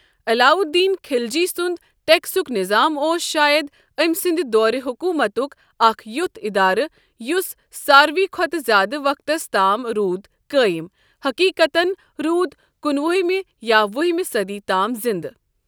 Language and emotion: Kashmiri, neutral